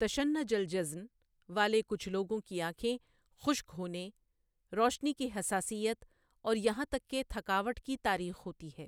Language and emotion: Urdu, neutral